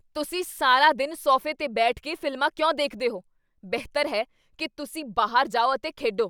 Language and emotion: Punjabi, angry